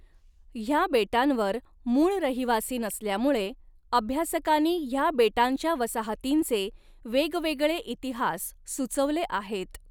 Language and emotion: Marathi, neutral